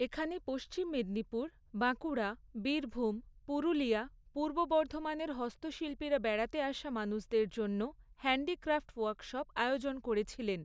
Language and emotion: Bengali, neutral